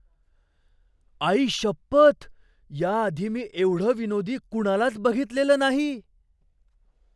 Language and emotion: Marathi, surprised